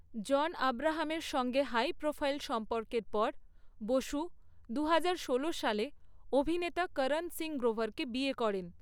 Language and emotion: Bengali, neutral